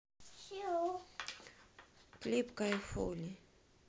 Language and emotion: Russian, neutral